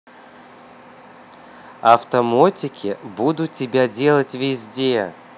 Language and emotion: Russian, positive